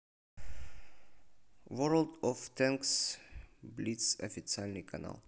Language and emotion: Russian, neutral